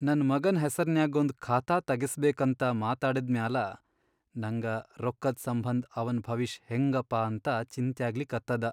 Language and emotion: Kannada, sad